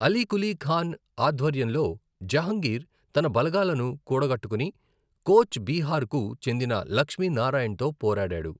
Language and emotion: Telugu, neutral